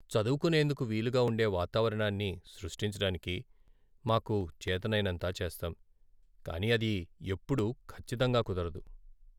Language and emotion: Telugu, sad